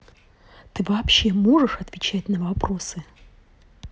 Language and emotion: Russian, angry